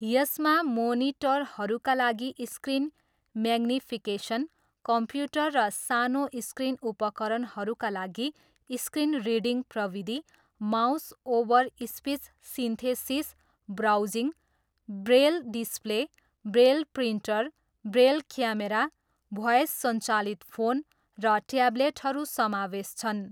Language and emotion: Nepali, neutral